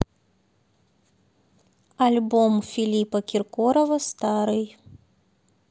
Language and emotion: Russian, neutral